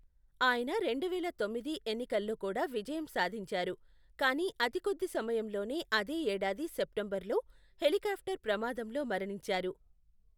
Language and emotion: Telugu, neutral